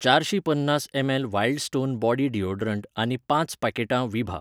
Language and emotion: Goan Konkani, neutral